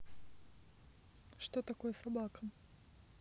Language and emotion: Russian, neutral